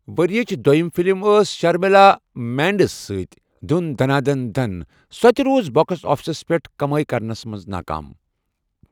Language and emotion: Kashmiri, neutral